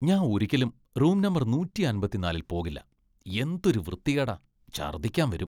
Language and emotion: Malayalam, disgusted